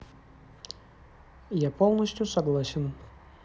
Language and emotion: Russian, neutral